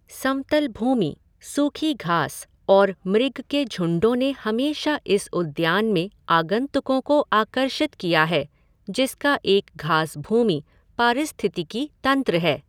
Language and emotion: Hindi, neutral